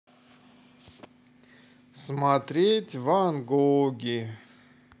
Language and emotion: Russian, positive